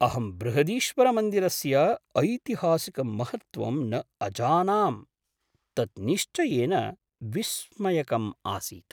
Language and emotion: Sanskrit, surprised